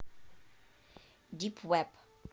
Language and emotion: Russian, neutral